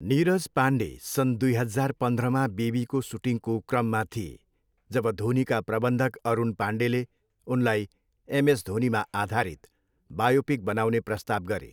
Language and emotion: Nepali, neutral